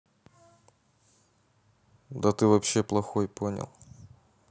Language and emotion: Russian, neutral